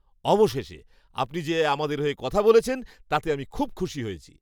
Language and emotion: Bengali, happy